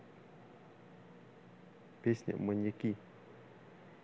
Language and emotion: Russian, neutral